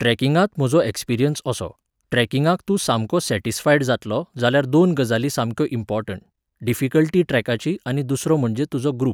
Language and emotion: Goan Konkani, neutral